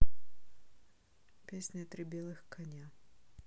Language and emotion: Russian, neutral